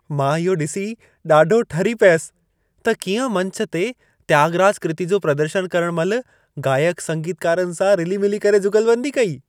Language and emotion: Sindhi, happy